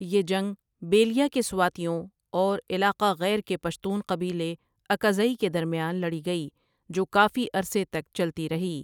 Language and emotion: Urdu, neutral